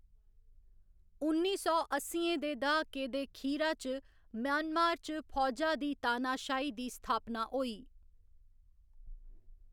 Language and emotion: Dogri, neutral